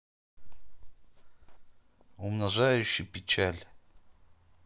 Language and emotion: Russian, neutral